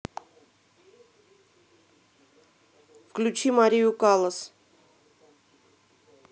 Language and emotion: Russian, neutral